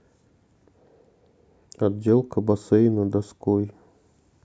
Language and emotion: Russian, sad